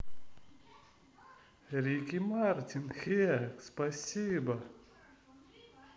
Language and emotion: Russian, positive